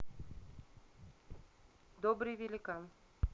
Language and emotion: Russian, neutral